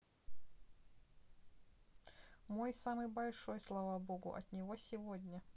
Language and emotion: Russian, neutral